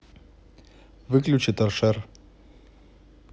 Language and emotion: Russian, neutral